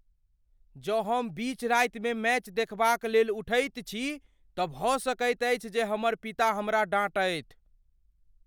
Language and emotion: Maithili, fearful